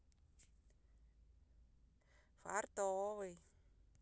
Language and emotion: Russian, positive